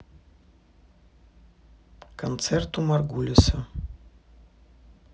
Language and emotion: Russian, neutral